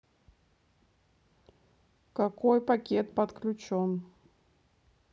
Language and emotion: Russian, neutral